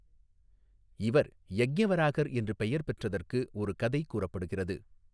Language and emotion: Tamil, neutral